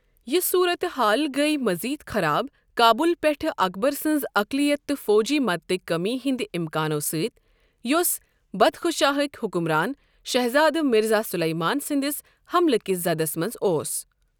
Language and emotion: Kashmiri, neutral